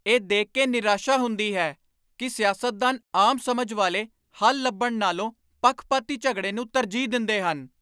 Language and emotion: Punjabi, angry